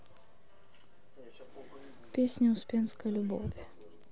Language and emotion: Russian, neutral